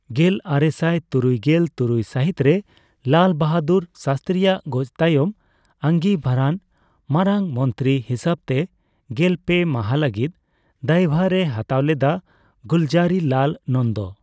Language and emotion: Santali, neutral